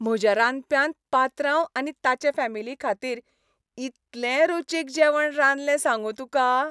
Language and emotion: Goan Konkani, happy